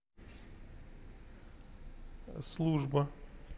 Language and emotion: Russian, neutral